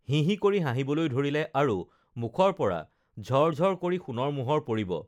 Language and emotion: Assamese, neutral